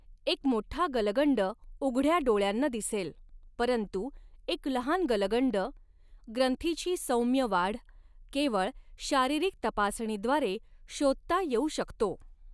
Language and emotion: Marathi, neutral